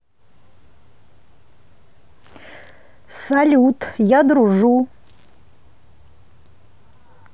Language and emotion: Russian, neutral